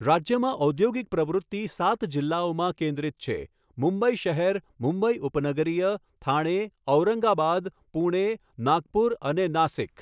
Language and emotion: Gujarati, neutral